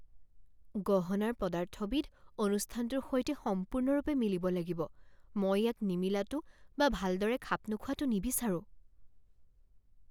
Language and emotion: Assamese, fearful